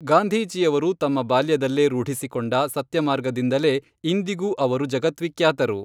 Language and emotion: Kannada, neutral